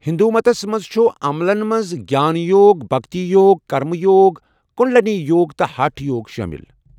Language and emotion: Kashmiri, neutral